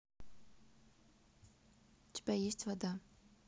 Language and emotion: Russian, neutral